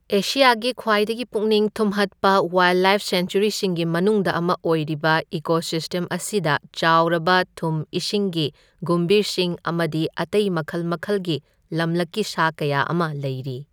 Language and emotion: Manipuri, neutral